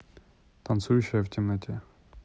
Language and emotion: Russian, neutral